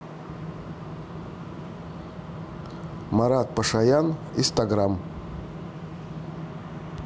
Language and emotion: Russian, neutral